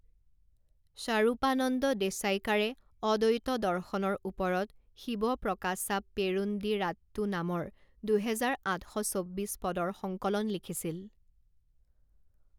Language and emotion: Assamese, neutral